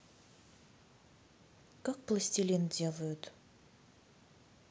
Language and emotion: Russian, neutral